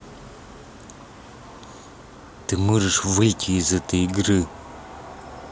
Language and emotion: Russian, angry